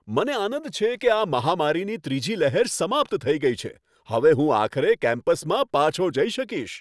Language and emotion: Gujarati, happy